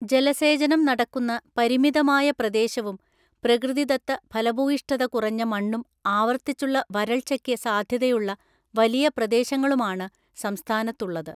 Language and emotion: Malayalam, neutral